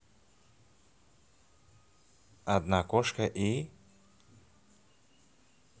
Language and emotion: Russian, neutral